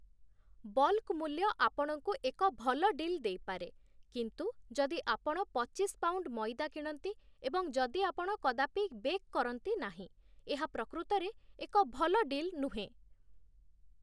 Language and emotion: Odia, neutral